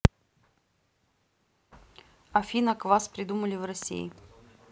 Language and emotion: Russian, neutral